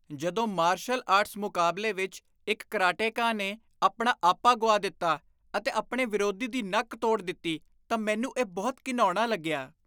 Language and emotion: Punjabi, disgusted